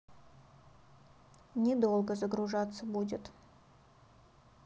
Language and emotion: Russian, neutral